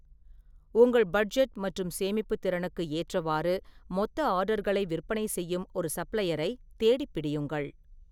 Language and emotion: Tamil, neutral